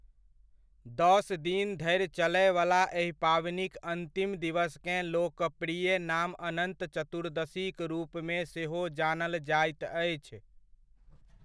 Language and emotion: Maithili, neutral